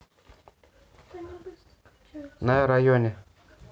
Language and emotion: Russian, neutral